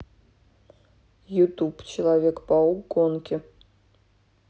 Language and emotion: Russian, neutral